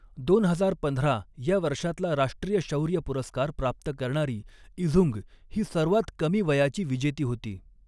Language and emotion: Marathi, neutral